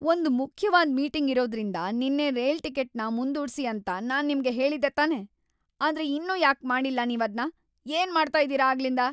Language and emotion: Kannada, angry